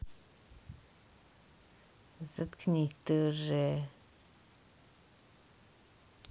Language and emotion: Russian, neutral